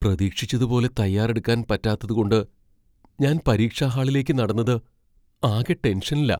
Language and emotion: Malayalam, fearful